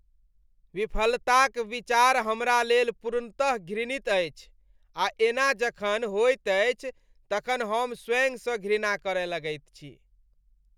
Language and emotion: Maithili, disgusted